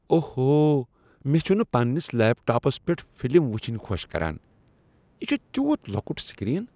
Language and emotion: Kashmiri, disgusted